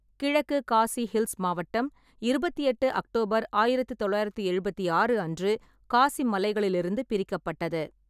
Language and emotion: Tamil, neutral